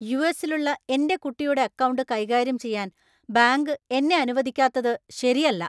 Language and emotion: Malayalam, angry